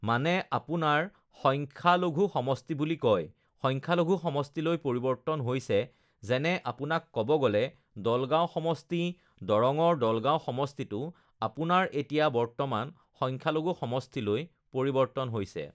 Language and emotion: Assamese, neutral